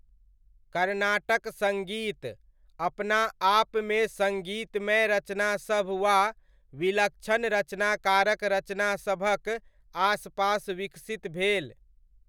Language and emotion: Maithili, neutral